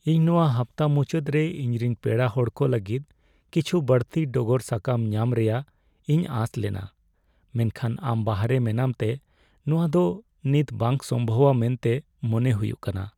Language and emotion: Santali, sad